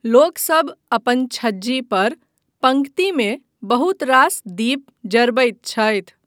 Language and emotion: Maithili, neutral